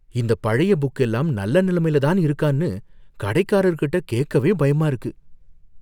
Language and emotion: Tamil, fearful